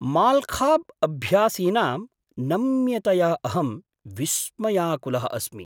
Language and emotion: Sanskrit, surprised